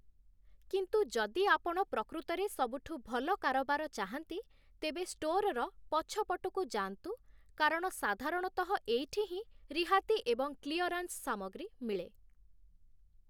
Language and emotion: Odia, neutral